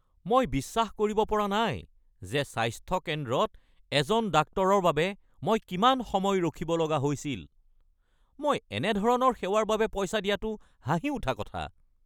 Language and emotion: Assamese, angry